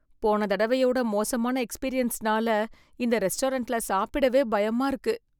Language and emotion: Tamil, fearful